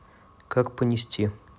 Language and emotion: Russian, neutral